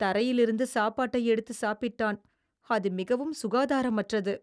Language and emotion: Tamil, disgusted